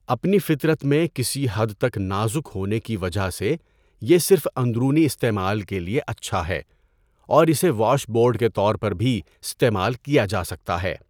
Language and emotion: Urdu, neutral